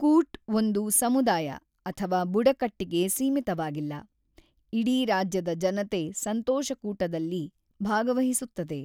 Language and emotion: Kannada, neutral